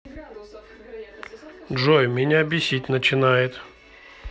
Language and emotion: Russian, neutral